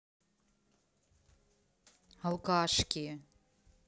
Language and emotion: Russian, angry